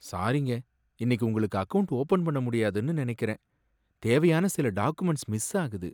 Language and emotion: Tamil, sad